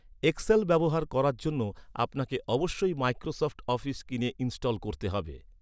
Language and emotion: Bengali, neutral